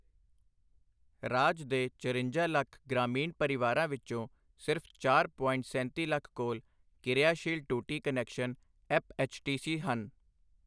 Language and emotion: Punjabi, neutral